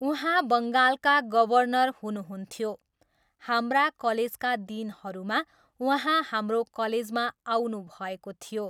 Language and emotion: Nepali, neutral